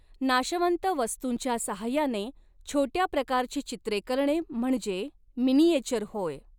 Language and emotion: Marathi, neutral